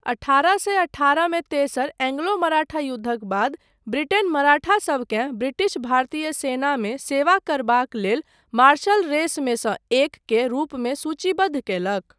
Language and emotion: Maithili, neutral